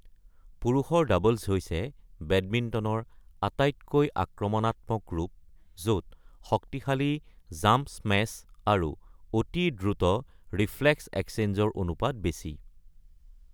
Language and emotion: Assamese, neutral